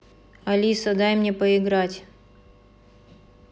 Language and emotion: Russian, neutral